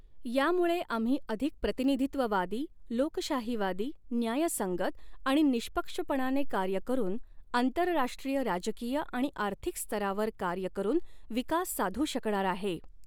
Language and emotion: Marathi, neutral